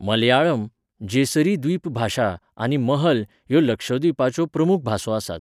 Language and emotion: Goan Konkani, neutral